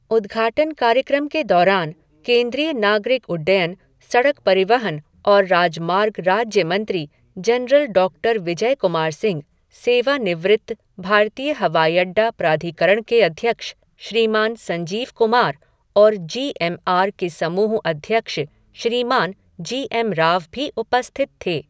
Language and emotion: Hindi, neutral